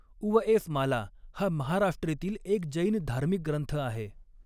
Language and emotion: Marathi, neutral